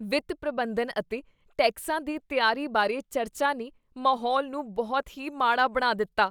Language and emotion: Punjabi, disgusted